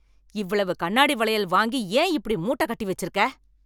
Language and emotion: Tamil, angry